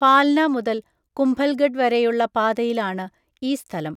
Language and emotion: Malayalam, neutral